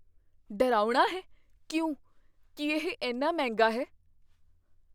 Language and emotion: Punjabi, fearful